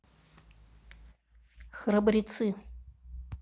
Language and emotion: Russian, neutral